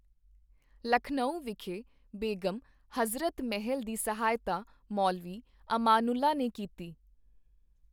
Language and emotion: Punjabi, neutral